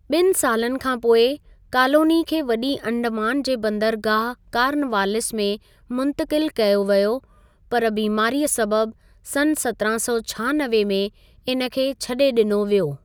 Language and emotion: Sindhi, neutral